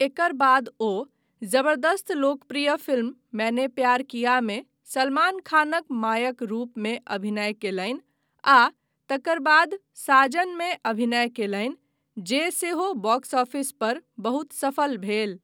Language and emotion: Maithili, neutral